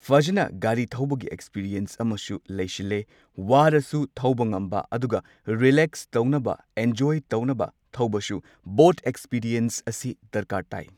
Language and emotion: Manipuri, neutral